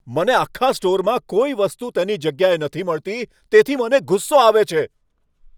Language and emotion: Gujarati, angry